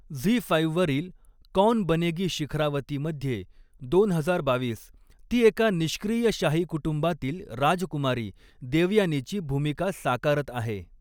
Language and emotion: Marathi, neutral